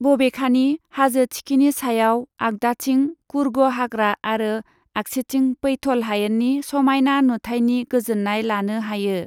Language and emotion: Bodo, neutral